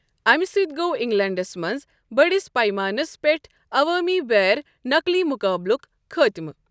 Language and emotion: Kashmiri, neutral